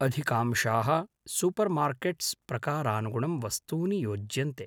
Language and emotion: Sanskrit, neutral